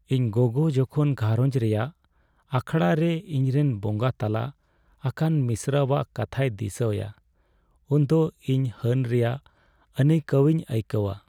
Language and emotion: Santali, sad